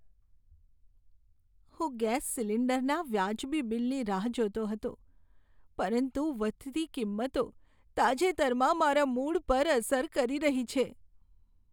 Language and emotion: Gujarati, sad